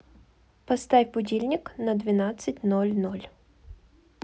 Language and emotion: Russian, neutral